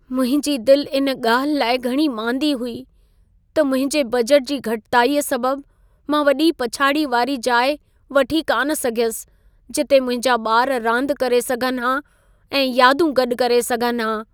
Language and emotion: Sindhi, sad